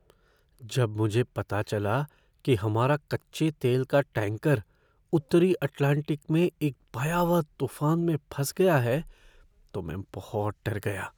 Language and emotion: Hindi, fearful